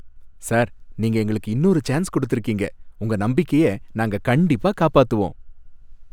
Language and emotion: Tamil, happy